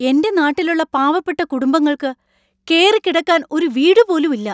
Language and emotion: Malayalam, angry